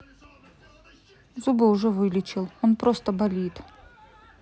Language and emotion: Russian, neutral